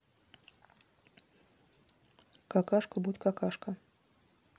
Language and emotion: Russian, neutral